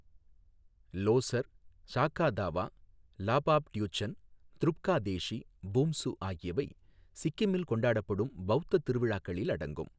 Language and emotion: Tamil, neutral